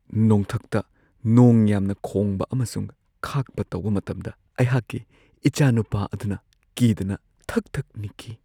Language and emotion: Manipuri, fearful